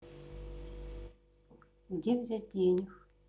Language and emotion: Russian, sad